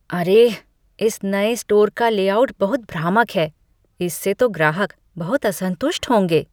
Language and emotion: Hindi, disgusted